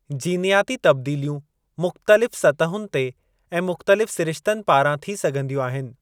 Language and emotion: Sindhi, neutral